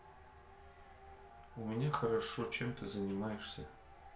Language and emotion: Russian, neutral